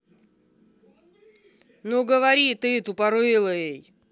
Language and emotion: Russian, angry